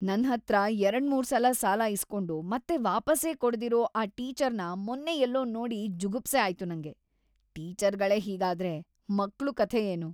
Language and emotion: Kannada, disgusted